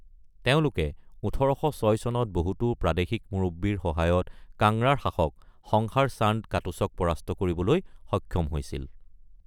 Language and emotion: Assamese, neutral